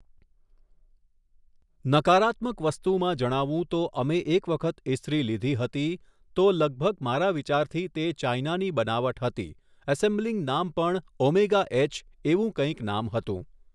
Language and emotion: Gujarati, neutral